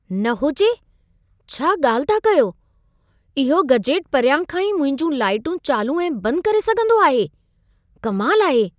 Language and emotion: Sindhi, surprised